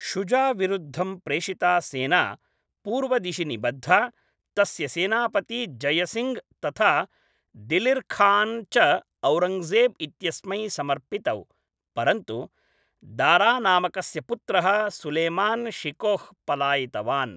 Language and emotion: Sanskrit, neutral